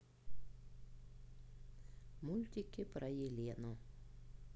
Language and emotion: Russian, neutral